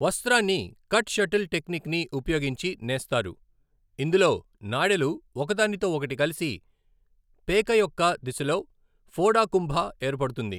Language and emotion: Telugu, neutral